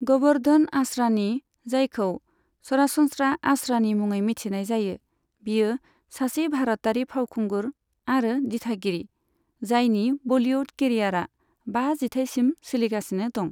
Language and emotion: Bodo, neutral